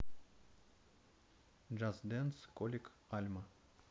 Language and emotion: Russian, neutral